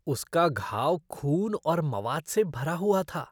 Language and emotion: Hindi, disgusted